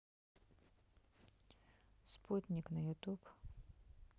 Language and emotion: Russian, neutral